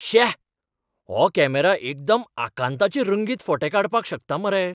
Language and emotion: Goan Konkani, surprised